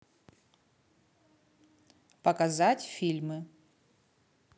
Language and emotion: Russian, neutral